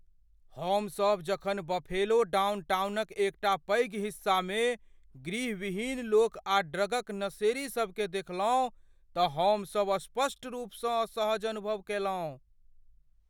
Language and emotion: Maithili, fearful